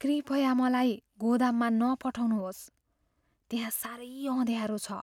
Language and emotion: Nepali, fearful